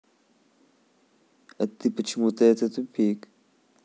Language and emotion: Russian, neutral